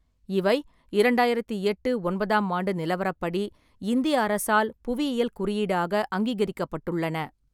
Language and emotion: Tamil, neutral